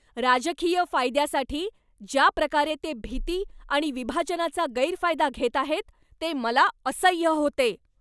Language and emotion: Marathi, angry